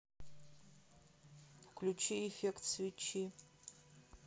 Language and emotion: Russian, neutral